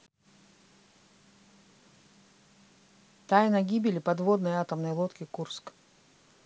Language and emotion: Russian, neutral